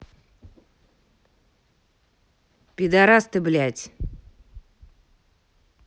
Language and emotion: Russian, angry